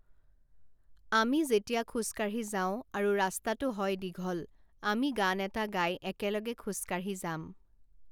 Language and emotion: Assamese, neutral